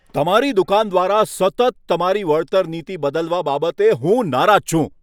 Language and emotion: Gujarati, angry